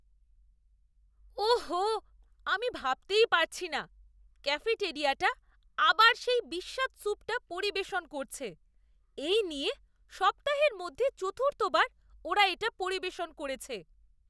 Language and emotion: Bengali, disgusted